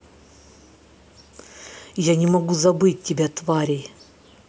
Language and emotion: Russian, angry